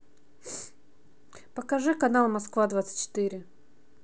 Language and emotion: Russian, neutral